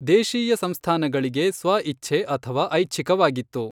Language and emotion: Kannada, neutral